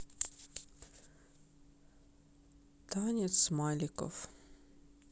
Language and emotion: Russian, sad